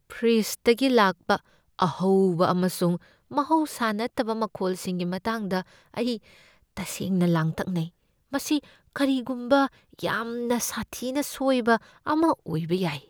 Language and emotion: Manipuri, fearful